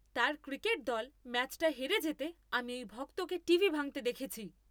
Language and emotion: Bengali, angry